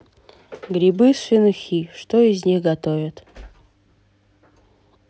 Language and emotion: Russian, neutral